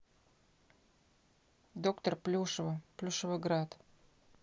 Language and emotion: Russian, neutral